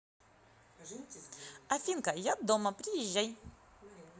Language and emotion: Russian, positive